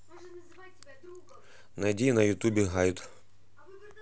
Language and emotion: Russian, neutral